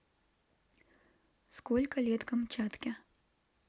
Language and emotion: Russian, neutral